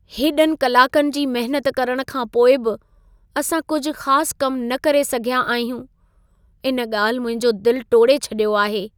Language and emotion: Sindhi, sad